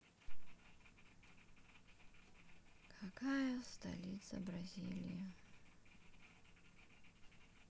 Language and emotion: Russian, sad